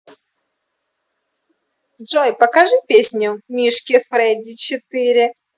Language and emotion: Russian, positive